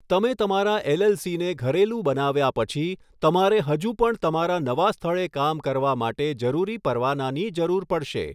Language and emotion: Gujarati, neutral